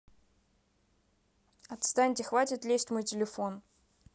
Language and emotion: Russian, angry